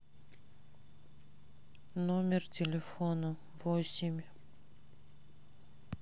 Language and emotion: Russian, sad